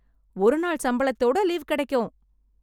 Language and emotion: Tamil, happy